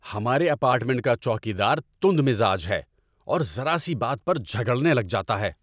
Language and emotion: Urdu, angry